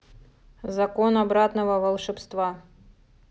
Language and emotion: Russian, neutral